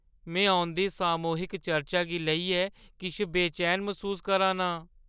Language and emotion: Dogri, fearful